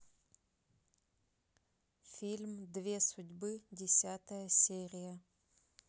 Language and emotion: Russian, neutral